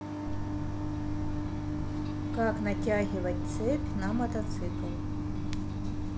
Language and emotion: Russian, neutral